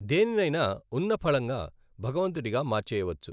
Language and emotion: Telugu, neutral